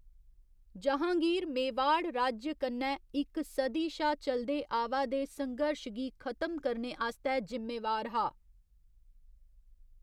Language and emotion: Dogri, neutral